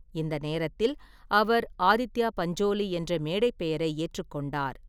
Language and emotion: Tamil, neutral